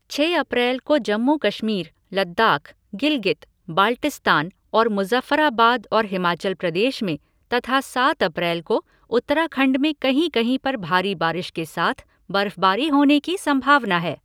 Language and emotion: Hindi, neutral